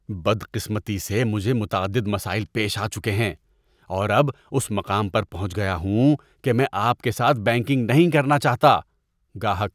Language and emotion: Urdu, disgusted